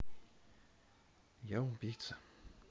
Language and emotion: Russian, sad